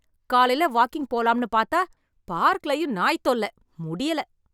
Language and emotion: Tamil, angry